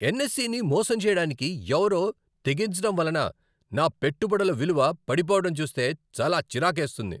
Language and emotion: Telugu, angry